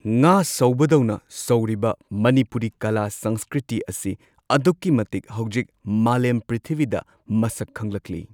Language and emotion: Manipuri, neutral